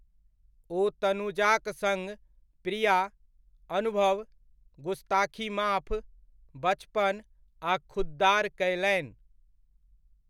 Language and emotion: Maithili, neutral